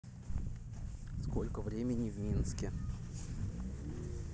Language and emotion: Russian, neutral